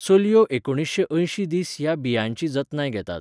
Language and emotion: Goan Konkani, neutral